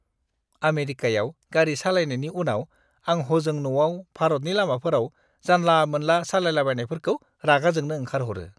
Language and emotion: Bodo, disgusted